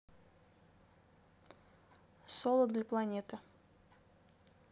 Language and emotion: Russian, neutral